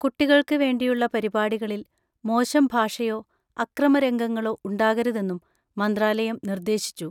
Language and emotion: Malayalam, neutral